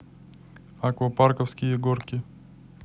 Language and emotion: Russian, neutral